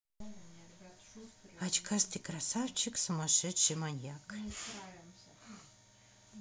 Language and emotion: Russian, neutral